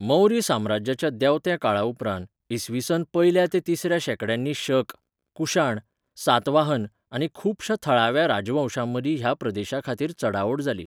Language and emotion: Goan Konkani, neutral